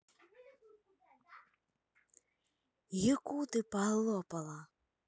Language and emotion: Russian, angry